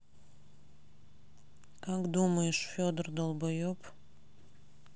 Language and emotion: Russian, sad